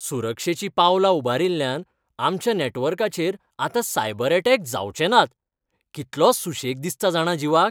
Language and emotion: Goan Konkani, happy